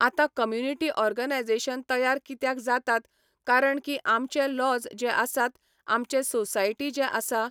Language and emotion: Goan Konkani, neutral